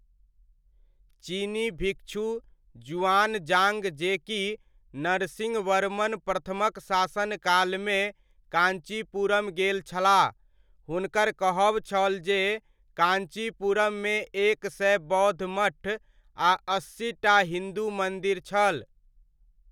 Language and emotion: Maithili, neutral